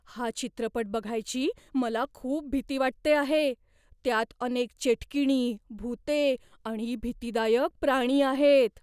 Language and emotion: Marathi, fearful